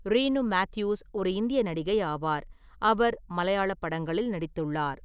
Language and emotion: Tamil, neutral